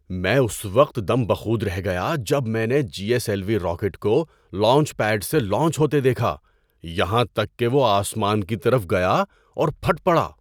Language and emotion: Urdu, surprised